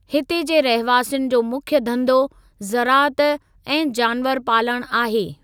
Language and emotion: Sindhi, neutral